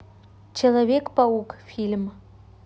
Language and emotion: Russian, neutral